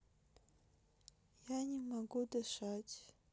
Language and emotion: Russian, sad